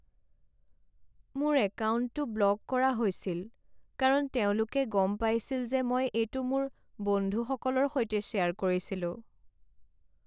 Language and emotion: Assamese, sad